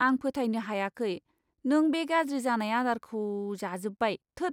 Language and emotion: Bodo, disgusted